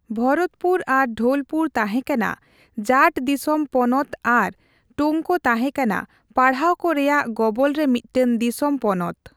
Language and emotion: Santali, neutral